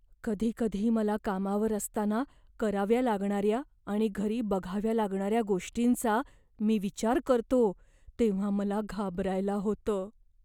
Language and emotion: Marathi, fearful